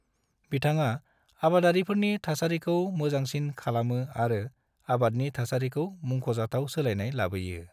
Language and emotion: Bodo, neutral